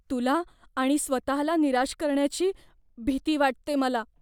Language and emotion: Marathi, fearful